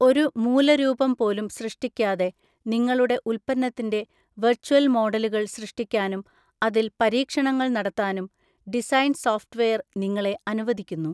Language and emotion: Malayalam, neutral